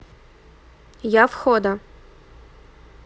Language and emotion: Russian, neutral